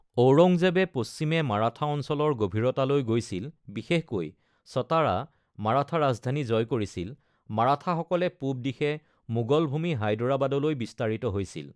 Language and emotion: Assamese, neutral